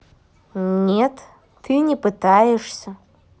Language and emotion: Russian, neutral